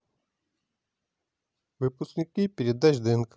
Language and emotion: Russian, neutral